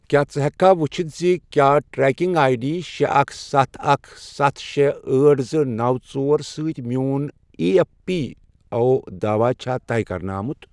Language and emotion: Kashmiri, neutral